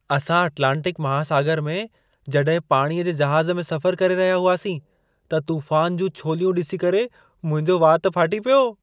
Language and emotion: Sindhi, surprised